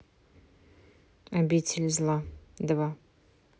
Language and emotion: Russian, neutral